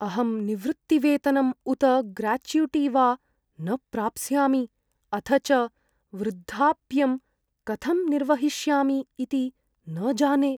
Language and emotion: Sanskrit, fearful